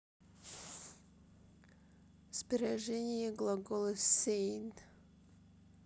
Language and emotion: Russian, neutral